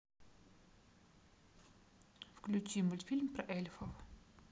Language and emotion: Russian, neutral